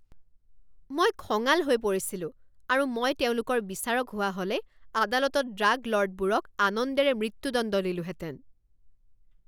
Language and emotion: Assamese, angry